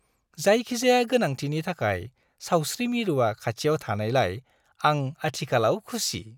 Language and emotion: Bodo, happy